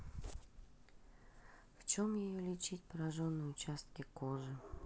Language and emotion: Russian, neutral